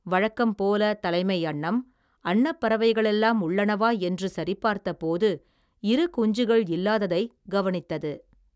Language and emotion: Tamil, neutral